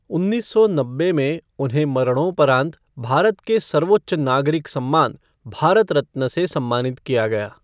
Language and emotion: Hindi, neutral